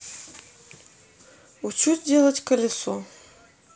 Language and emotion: Russian, neutral